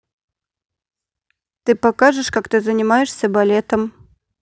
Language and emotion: Russian, neutral